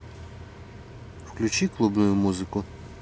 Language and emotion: Russian, neutral